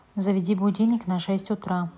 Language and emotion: Russian, neutral